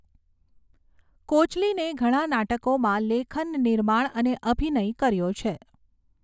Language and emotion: Gujarati, neutral